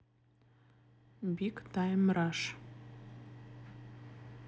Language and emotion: Russian, neutral